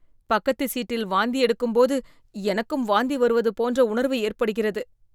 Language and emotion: Tamil, disgusted